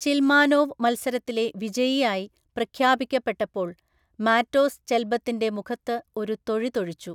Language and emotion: Malayalam, neutral